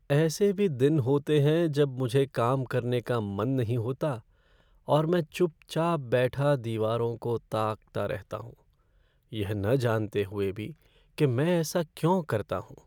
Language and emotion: Hindi, sad